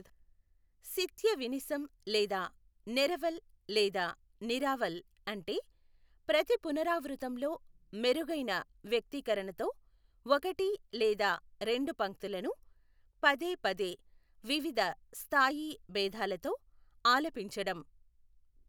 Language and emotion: Telugu, neutral